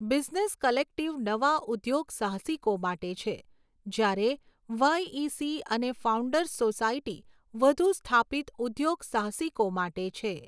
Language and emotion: Gujarati, neutral